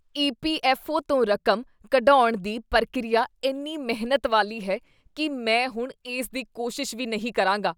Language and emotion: Punjabi, disgusted